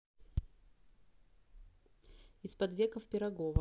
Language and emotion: Russian, neutral